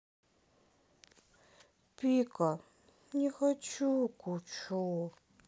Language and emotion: Russian, sad